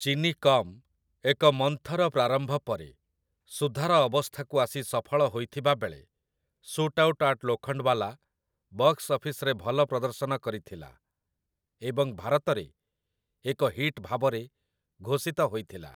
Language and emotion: Odia, neutral